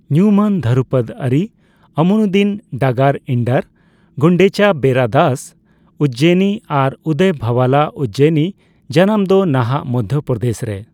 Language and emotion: Santali, neutral